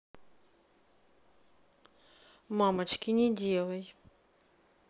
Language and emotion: Russian, neutral